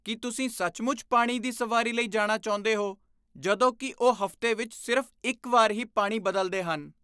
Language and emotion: Punjabi, disgusted